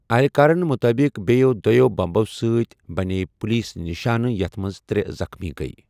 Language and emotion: Kashmiri, neutral